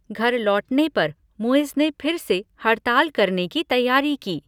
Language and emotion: Hindi, neutral